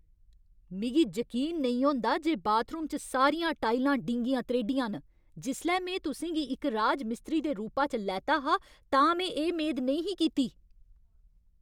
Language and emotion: Dogri, angry